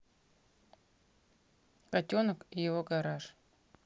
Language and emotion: Russian, neutral